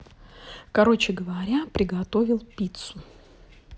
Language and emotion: Russian, neutral